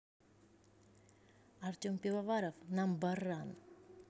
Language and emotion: Russian, neutral